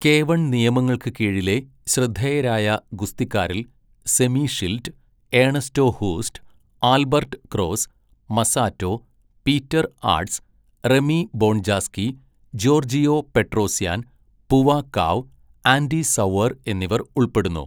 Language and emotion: Malayalam, neutral